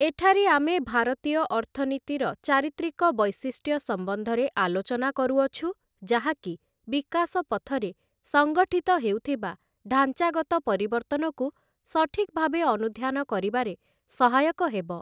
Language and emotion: Odia, neutral